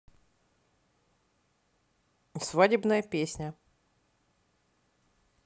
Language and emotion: Russian, neutral